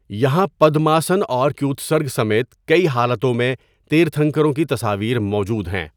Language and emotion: Urdu, neutral